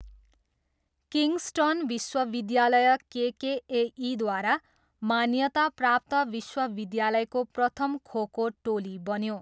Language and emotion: Nepali, neutral